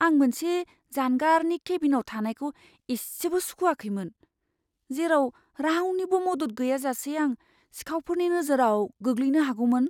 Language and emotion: Bodo, fearful